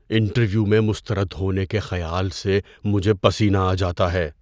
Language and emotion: Urdu, fearful